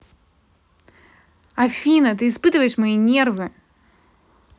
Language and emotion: Russian, angry